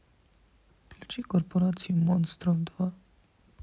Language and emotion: Russian, sad